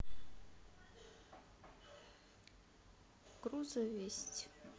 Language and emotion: Russian, sad